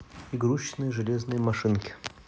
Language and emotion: Russian, neutral